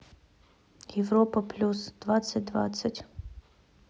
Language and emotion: Russian, neutral